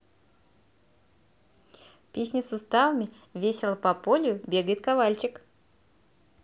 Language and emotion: Russian, positive